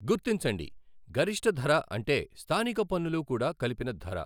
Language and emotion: Telugu, neutral